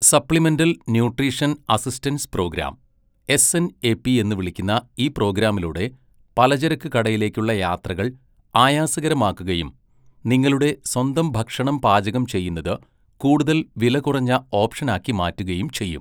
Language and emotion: Malayalam, neutral